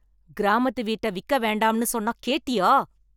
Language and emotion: Tamil, angry